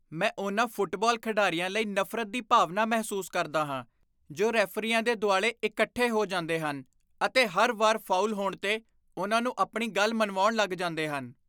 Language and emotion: Punjabi, disgusted